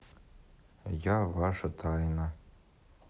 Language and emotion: Russian, neutral